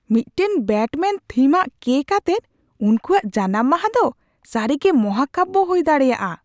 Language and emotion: Santali, surprised